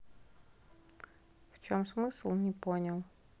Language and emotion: Russian, neutral